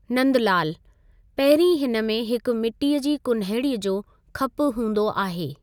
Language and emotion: Sindhi, neutral